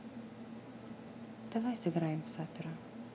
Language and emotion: Russian, neutral